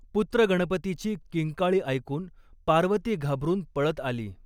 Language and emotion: Marathi, neutral